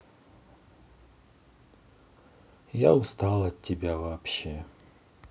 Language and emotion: Russian, sad